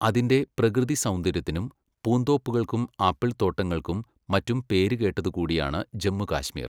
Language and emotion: Malayalam, neutral